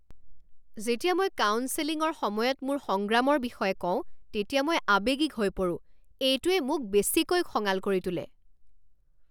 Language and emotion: Assamese, angry